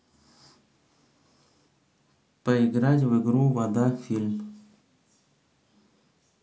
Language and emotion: Russian, neutral